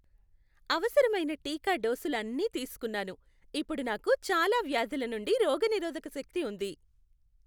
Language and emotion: Telugu, happy